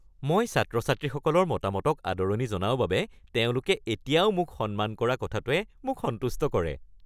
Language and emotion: Assamese, happy